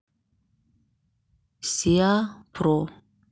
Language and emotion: Russian, neutral